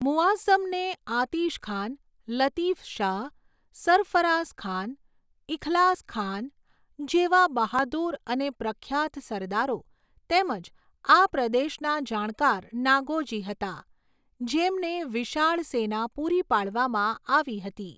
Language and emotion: Gujarati, neutral